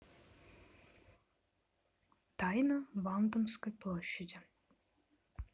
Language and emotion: Russian, neutral